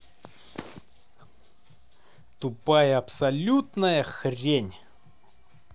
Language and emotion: Russian, angry